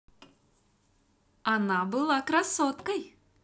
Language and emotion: Russian, positive